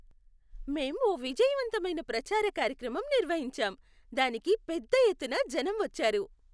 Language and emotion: Telugu, happy